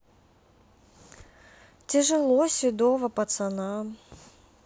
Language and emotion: Russian, sad